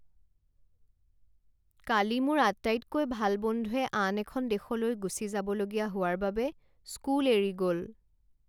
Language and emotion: Assamese, sad